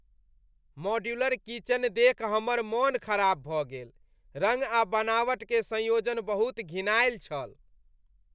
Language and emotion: Maithili, disgusted